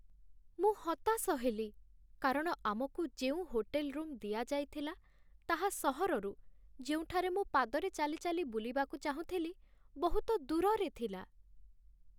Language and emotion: Odia, sad